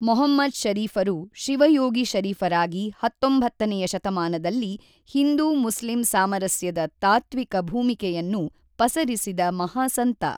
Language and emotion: Kannada, neutral